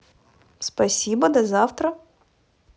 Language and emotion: Russian, positive